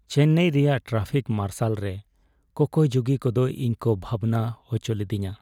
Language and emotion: Santali, sad